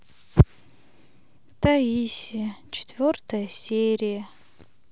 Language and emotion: Russian, sad